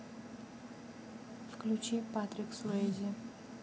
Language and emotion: Russian, neutral